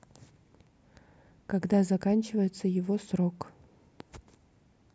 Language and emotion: Russian, neutral